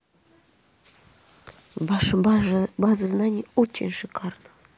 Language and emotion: Russian, neutral